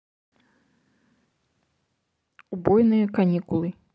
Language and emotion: Russian, neutral